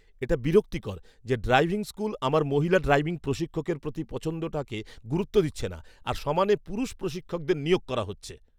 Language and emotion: Bengali, angry